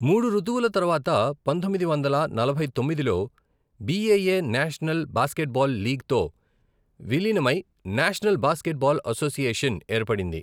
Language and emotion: Telugu, neutral